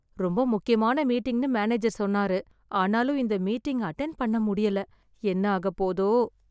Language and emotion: Tamil, fearful